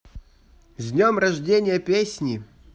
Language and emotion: Russian, positive